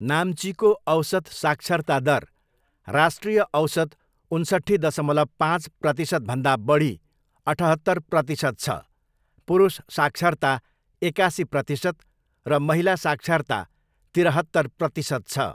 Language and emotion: Nepali, neutral